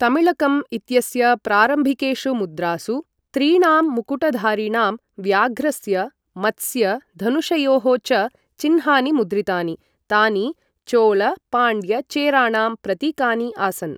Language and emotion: Sanskrit, neutral